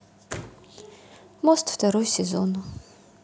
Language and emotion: Russian, sad